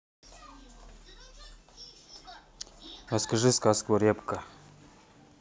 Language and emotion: Russian, neutral